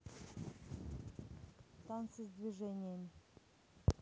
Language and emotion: Russian, neutral